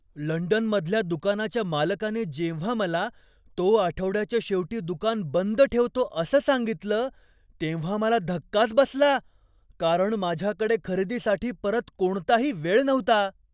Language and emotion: Marathi, surprised